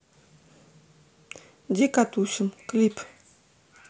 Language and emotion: Russian, neutral